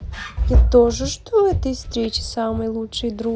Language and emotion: Russian, positive